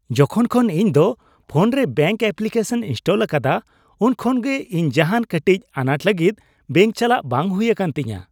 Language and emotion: Santali, happy